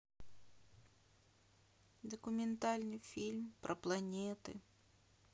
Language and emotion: Russian, sad